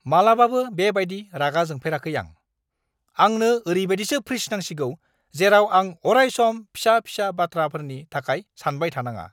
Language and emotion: Bodo, angry